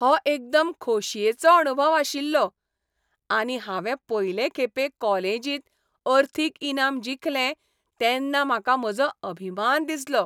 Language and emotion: Goan Konkani, happy